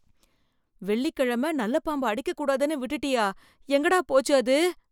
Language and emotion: Tamil, fearful